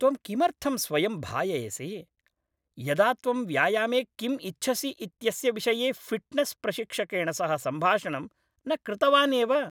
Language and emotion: Sanskrit, angry